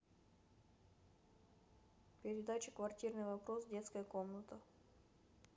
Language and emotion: Russian, neutral